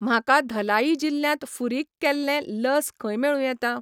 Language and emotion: Goan Konkani, neutral